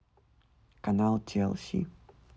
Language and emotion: Russian, neutral